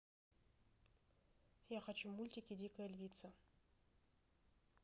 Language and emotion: Russian, neutral